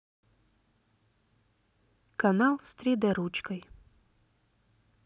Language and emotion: Russian, neutral